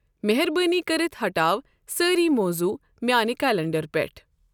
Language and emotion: Kashmiri, neutral